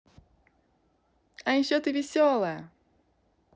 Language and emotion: Russian, positive